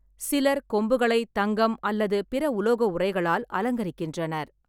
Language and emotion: Tamil, neutral